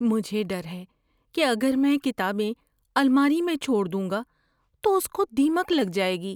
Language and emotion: Urdu, fearful